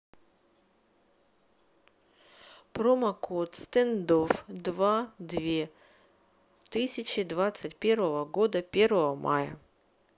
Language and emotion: Russian, neutral